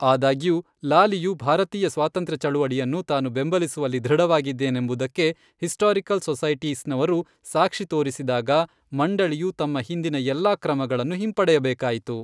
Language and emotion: Kannada, neutral